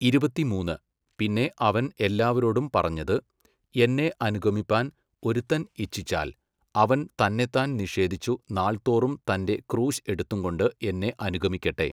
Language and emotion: Malayalam, neutral